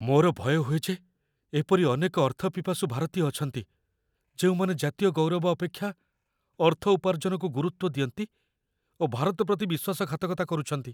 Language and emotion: Odia, fearful